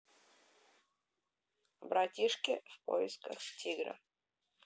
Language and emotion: Russian, neutral